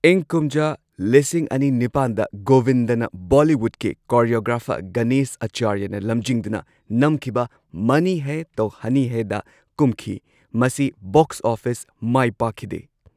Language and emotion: Manipuri, neutral